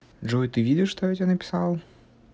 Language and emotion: Russian, neutral